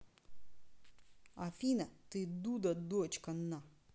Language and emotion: Russian, angry